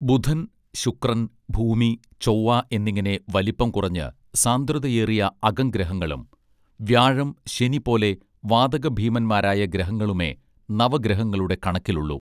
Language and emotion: Malayalam, neutral